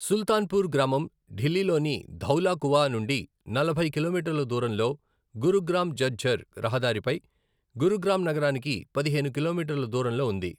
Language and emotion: Telugu, neutral